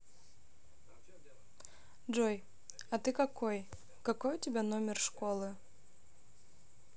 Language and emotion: Russian, neutral